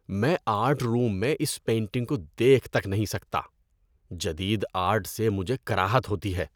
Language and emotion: Urdu, disgusted